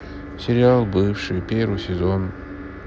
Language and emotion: Russian, sad